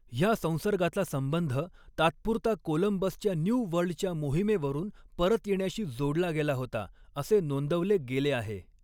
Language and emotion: Marathi, neutral